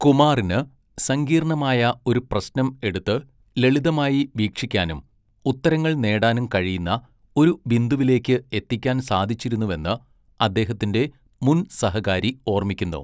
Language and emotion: Malayalam, neutral